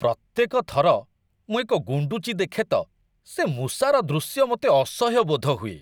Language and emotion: Odia, disgusted